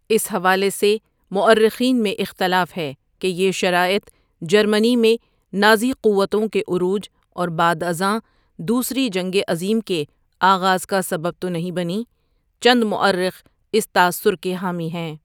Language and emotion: Urdu, neutral